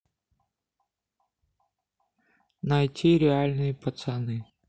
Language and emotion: Russian, neutral